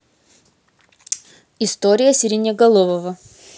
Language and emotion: Russian, neutral